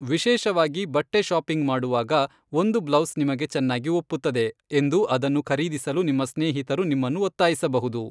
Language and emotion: Kannada, neutral